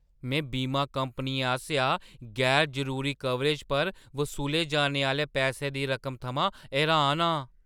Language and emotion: Dogri, surprised